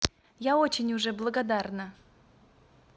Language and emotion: Russian, positive